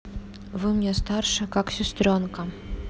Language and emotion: Russian, neutral